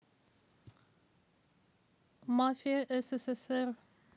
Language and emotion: Russian, neutral